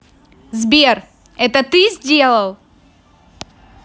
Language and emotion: Russian, angry